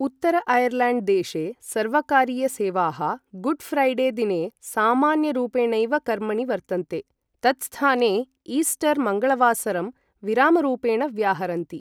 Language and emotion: Sanskrit, neutral